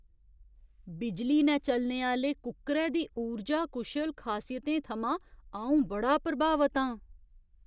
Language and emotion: Dogri, surprised